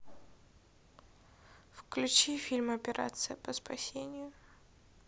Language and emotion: Russian, sad